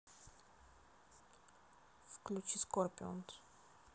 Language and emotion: Russian, neutral